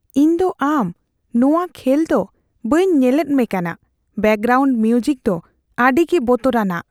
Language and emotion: Santali, fearful